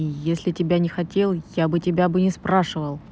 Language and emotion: Russian, angry